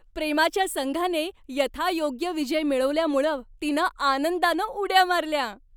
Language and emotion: Marathi, happy